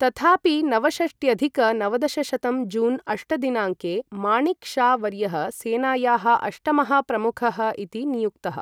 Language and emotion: Sanskrit, neutral